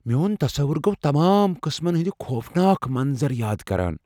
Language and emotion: Kashmiri, fearful